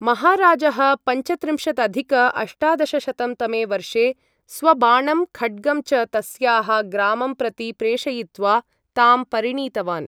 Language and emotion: Sanskrit, neutral